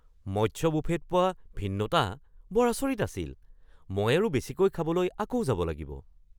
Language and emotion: Assamese, surprised